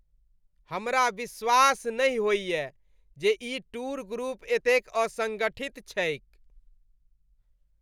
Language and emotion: Maithili, disgusted